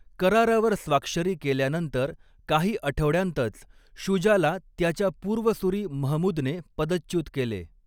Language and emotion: Marathi, neutral